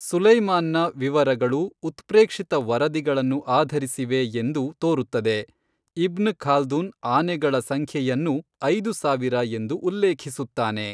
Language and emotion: Kannada, neutral